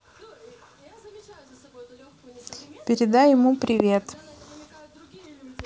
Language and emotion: Russian, neutral